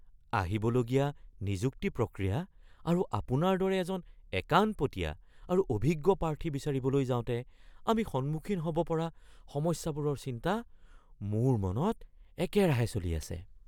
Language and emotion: Assamese, fearful